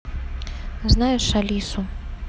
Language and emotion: Russian, neutral